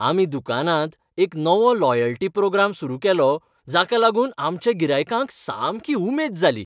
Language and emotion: Goan Konkani, happy